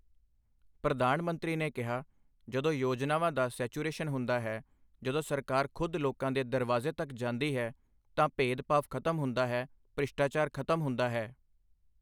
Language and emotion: Punjabi, neutral